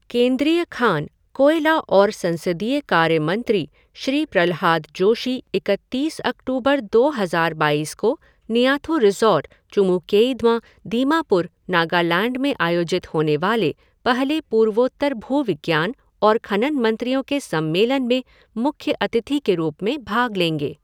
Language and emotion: Hindi, neutral